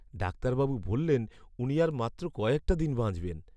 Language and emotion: Bengali, sad